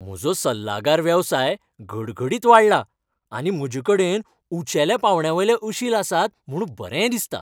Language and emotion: Goan Konkani, happy